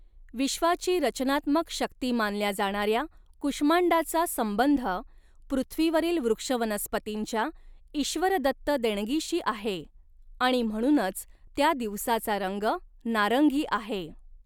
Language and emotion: Marathi, neutral